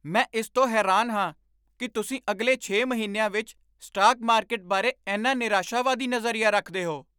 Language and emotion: Punjabi, surprised